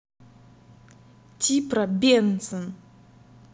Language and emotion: Russian, angry